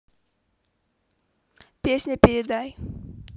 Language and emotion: Russian, positive